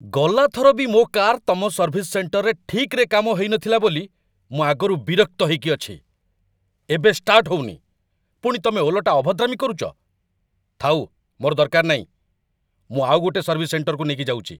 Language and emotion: Odia, angry